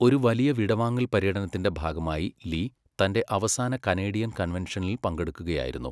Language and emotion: Malayalam, neutral